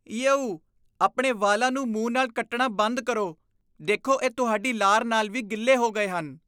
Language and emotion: Punjabi, disgusted